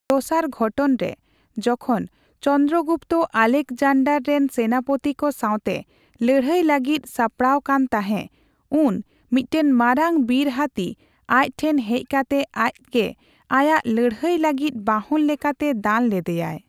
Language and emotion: Santali, neutral